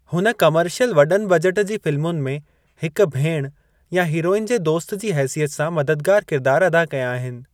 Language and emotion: Sindhi, neutral